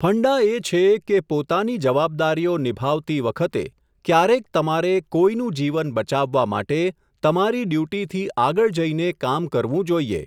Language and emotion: Gujarati, neutral